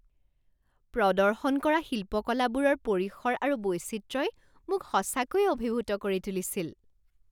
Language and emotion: Assamese, surprised